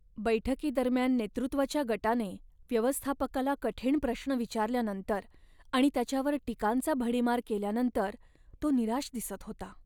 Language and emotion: Marathi, sad